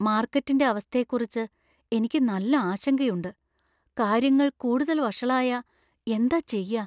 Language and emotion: Malayalam, fearful